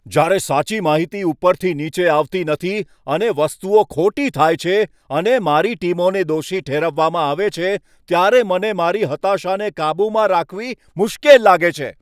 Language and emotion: Gujarati, angry